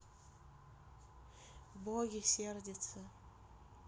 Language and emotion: Russian, neutral